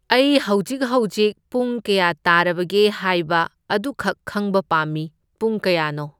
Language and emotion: Manipuri, neutral